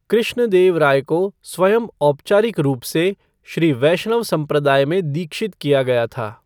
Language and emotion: Hindi, neutral